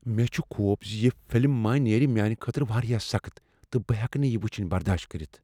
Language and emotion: Kashmiri, fearful